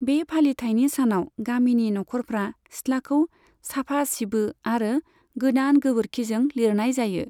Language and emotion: Bodo, neutral